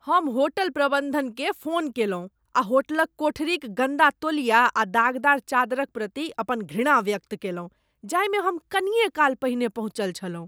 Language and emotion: Maithili, disgusted